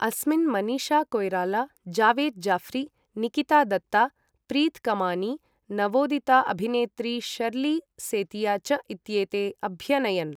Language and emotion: Sanskrit, neutral